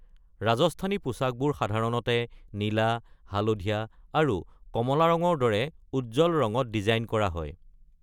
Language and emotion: Assamese, neutral